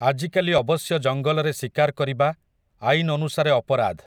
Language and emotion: Odia, neutral